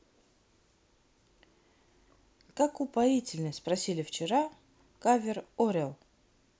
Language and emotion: Russian, neutral